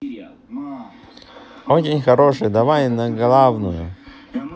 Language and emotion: Russian, positive